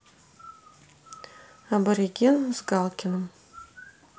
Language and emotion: Russian, neutral